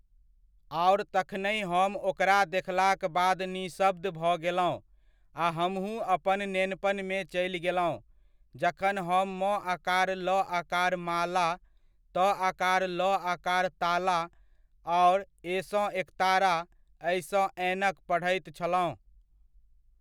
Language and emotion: Maithili, neutral